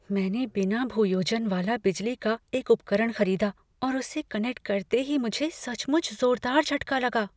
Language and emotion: Hindi, fearful